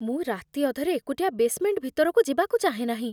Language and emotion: Odia, fearful